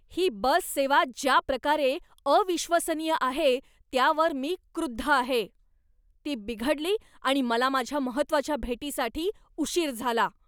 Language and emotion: Marathi, angry